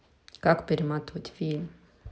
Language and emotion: Russian, neutral